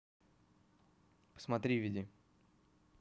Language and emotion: Russian, neutral